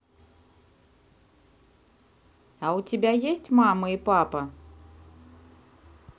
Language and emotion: Russian, neutral